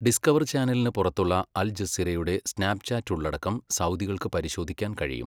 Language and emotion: Malayalam, neutral